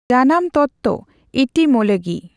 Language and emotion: Santali, neutral